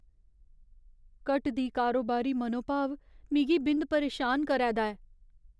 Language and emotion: Dogri, fearful